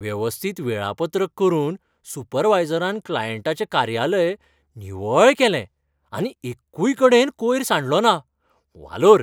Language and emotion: Goan Konkani, happy